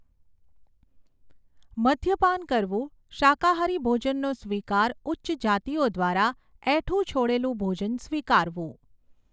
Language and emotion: Gujarati, neutral